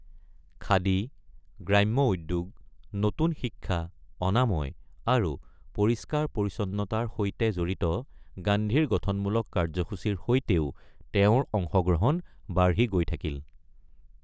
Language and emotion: Assamese, neutral